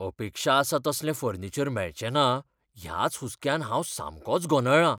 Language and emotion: Goan Konkani, fearful